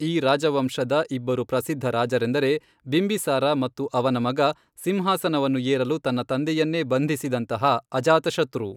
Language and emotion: Kannada, neutral